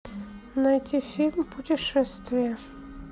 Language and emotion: Russian, neutral